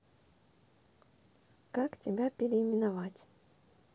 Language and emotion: Russian, neutral